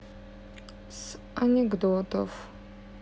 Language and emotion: Russian, neutral